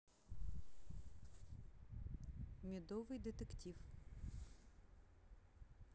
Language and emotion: Russian, neutral